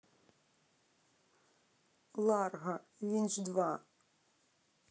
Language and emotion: Russian, sad